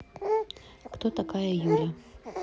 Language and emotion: Russian, neutral